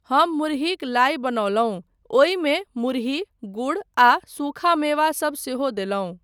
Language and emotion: Maithili, neutral